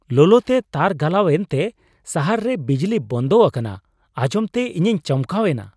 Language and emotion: Santali, surprised